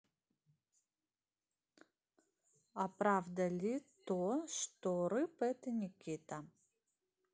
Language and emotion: Russian, neutral